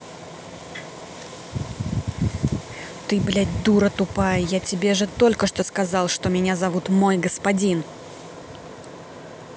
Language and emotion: Russian, angry